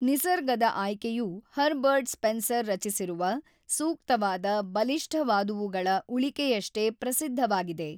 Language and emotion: Kannada, neutral